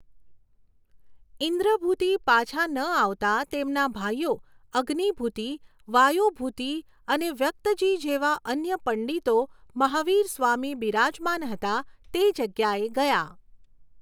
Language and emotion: Gujarati, neutral